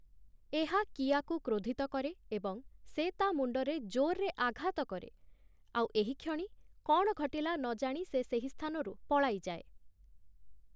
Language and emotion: Odia, neutral